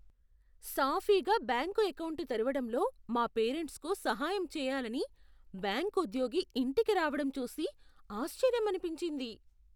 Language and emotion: Telugu, surprised